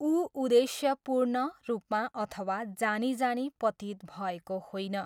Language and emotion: Nepali, neutral